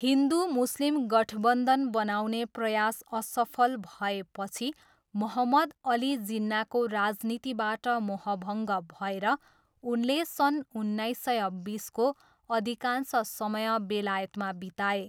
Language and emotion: Nepali, neutral